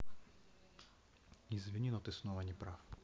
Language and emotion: Russian, neutral